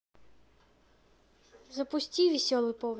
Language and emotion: Russian, neutral